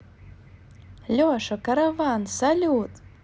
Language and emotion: Russian, positive